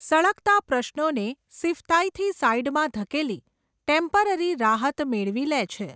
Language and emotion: Gujarati, neutral